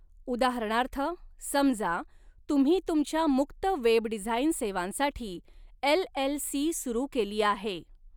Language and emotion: Marathi, neutral